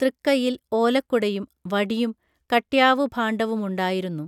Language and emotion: Malayalam, neutral